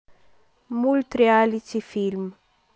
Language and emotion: Russian, neutral